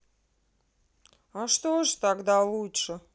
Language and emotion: Russian, neutral